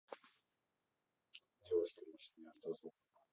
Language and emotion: Russian, neutral